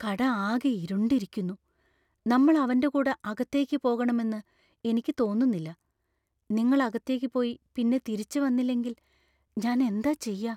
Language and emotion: Malayalam, fearful